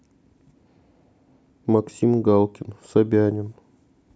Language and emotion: Russian, neutral